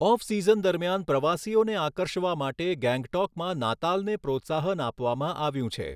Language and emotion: Gujarati, neutral